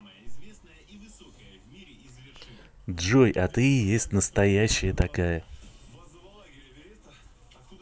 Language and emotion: Russian, positive